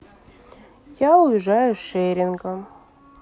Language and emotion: Russian, sad